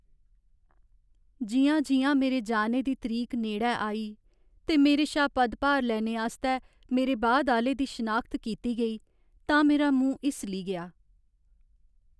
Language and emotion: Dogri, sad